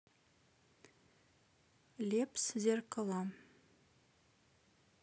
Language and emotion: Russian, neutral